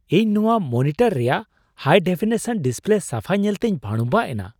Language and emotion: Santali, surprised